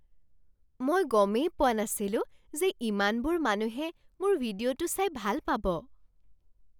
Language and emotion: Assamese, surprised